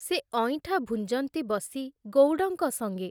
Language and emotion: Odia, neutral